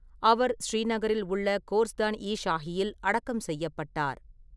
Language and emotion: Tamil, neutral